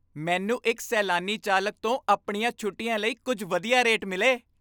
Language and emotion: Punjabi, happy